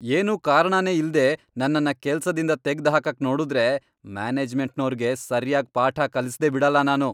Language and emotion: Kannada, angry